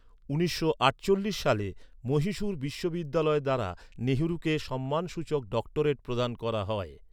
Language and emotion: Bengali, neutral